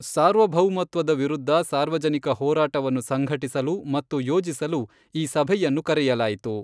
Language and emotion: Kannada, neutral